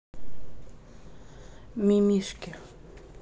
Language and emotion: Russian, neutral